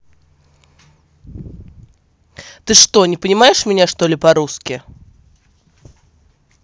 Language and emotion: Russian, angry